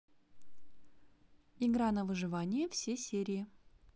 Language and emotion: Russian, positive